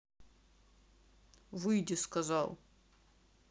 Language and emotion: Russian, angry